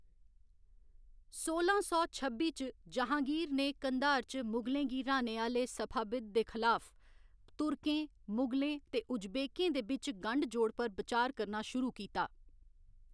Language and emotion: Dogri, neutral